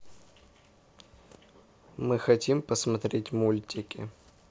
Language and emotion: Russian, neutral